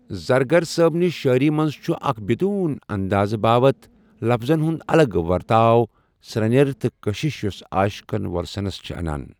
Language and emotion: Kashmiri, neutral